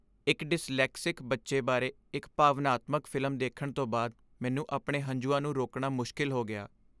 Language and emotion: Punjabi, sad